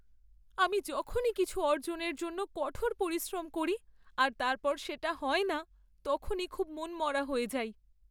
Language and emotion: Bengali, sad